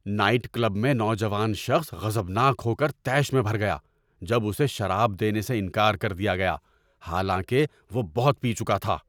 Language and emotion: Urdu, angry